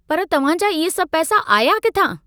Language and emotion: Sindhi, angry